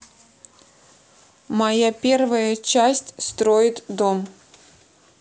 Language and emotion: Russian, neutral